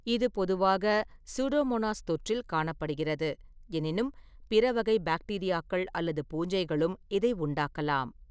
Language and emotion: Tamil, neutral